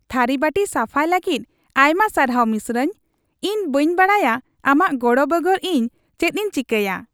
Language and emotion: Santali, happy